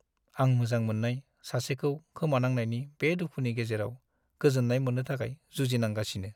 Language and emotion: Bodo, sad